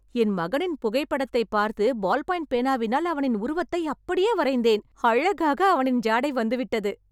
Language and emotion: Tamil, happy